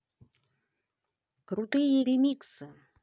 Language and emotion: Russian, positive